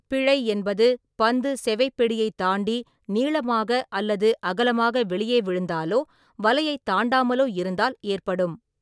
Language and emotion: Tamil, neutral